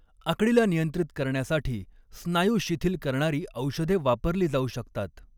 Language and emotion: Marathi, neutral